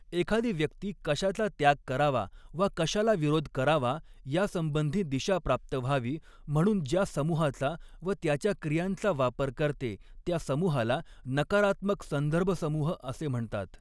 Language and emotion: Marathi, neutral